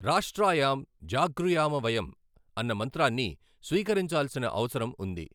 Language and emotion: Telugu, neutral